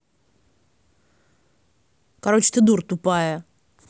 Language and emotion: Russian, angry